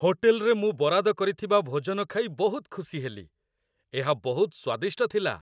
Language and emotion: Odia, happy